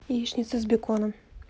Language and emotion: Russian, neutral